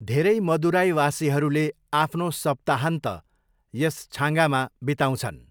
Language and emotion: Nepali, neutral